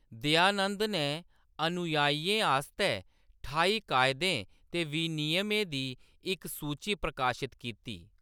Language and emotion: Dogri, neutral